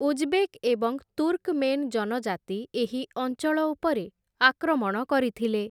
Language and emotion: Odia, neutral